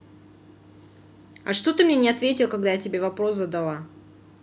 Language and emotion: Russian, angry